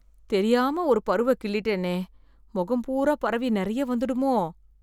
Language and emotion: Tamil, fearful